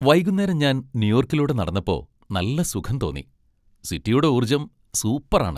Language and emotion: Malayalam, happy